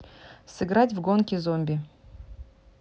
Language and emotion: Russian, neutral